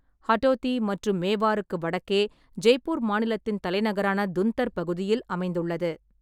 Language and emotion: Tamil, neutral